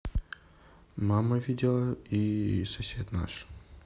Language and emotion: Russian, neutral